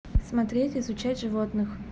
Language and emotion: Russian, neutral